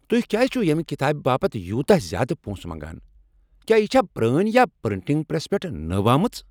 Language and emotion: Kashmiri, angry